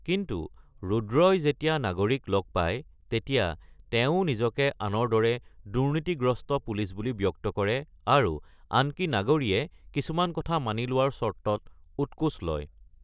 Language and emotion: Assamese, neutral